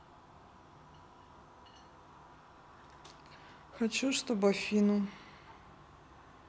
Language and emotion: Russian, neutral